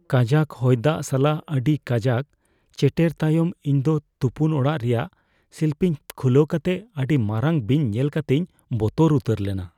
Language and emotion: Santali, fearful